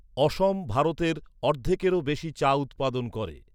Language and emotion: Bengali, neutral